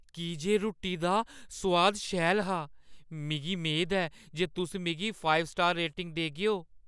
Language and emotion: Dogri, fearful